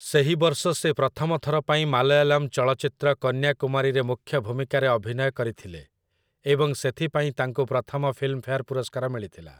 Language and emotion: Odia, neutral